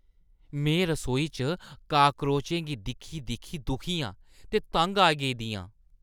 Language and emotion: Dogri, disgusted